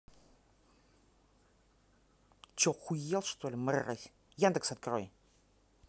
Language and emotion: Russian, angry